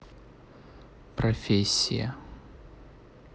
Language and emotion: Russian, neutral